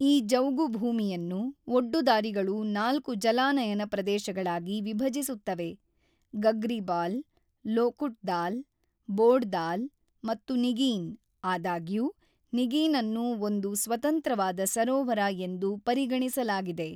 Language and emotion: Kannada, neutral